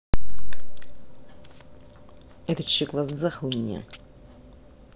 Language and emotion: Russian, angry